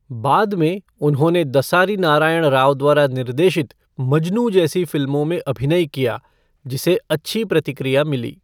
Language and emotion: Hindi, neutral